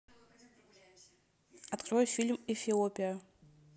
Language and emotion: Russian, neutral